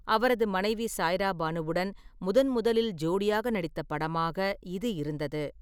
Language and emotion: Tamil, neutral